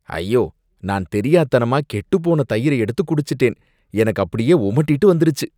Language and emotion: Tamil, disgusted